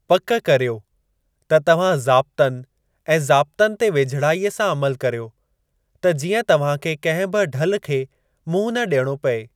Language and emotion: Sindhi, neutral